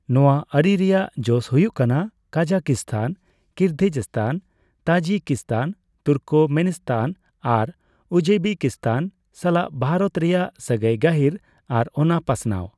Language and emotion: Santali, neutral